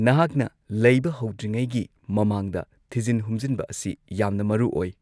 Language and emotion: Manipuri, neutral